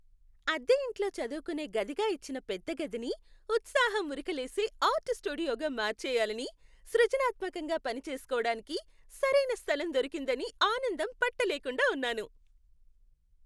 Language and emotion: Telugu, happy